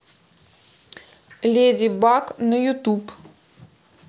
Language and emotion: Russian, neutral